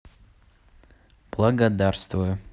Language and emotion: Russian, neutral